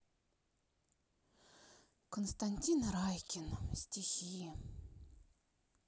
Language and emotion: Russian, sad